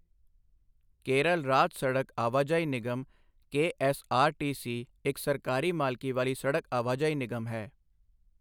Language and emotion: Punjabi, neutral